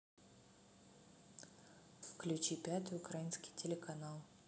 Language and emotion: Russian, neutral